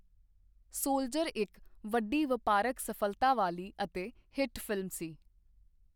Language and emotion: Punjabi, neutral